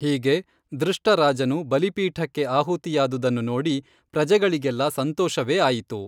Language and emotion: Kannada, neutral